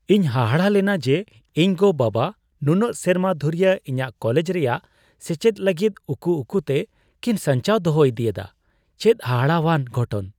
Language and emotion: Santali, surprised